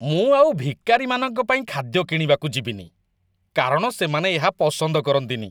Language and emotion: Odia, disgusted